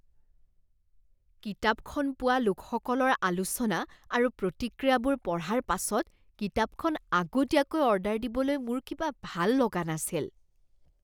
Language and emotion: Assamese, disgusted